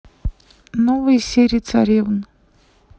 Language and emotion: Russian, neutral